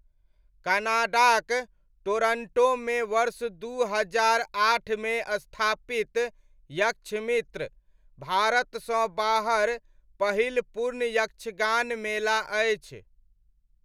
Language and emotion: Maithili, neutral